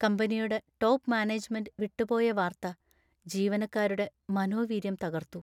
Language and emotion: Malayalam, sad